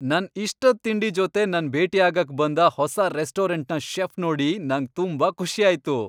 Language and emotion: Kannada, happy